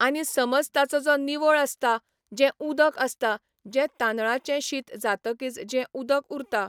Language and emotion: Goan Konkani, neutral